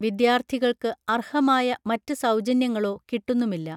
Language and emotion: Malayalam, neutral